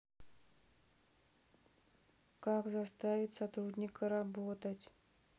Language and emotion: Russian, sad